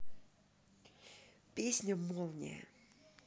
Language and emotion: Russian, neutral